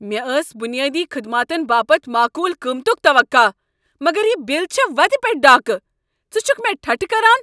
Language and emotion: Kashmiri, angry